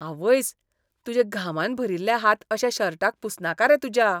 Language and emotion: Goan Konkani, disgusted